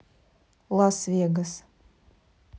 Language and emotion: Russian, neutral